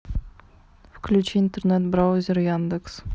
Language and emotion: Russian, neutral